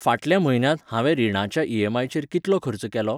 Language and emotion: Goan Konkani, neutral